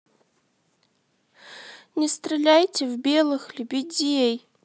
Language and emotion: Russian, sad